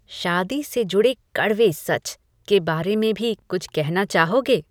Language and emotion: Hindi, disgusted